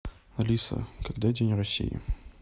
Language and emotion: Russian, neutral